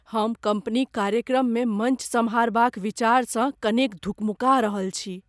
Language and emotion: Maithili, fearful